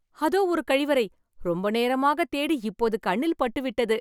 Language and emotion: Tamil, happy